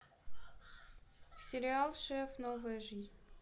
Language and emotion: Russian, neutral